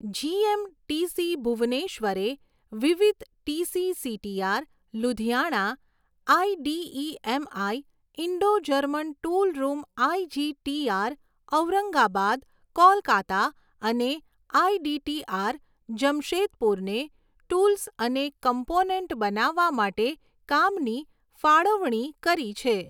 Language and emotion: Gujarati, neutral